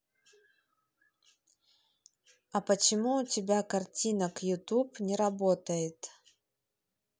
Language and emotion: Russian, neutral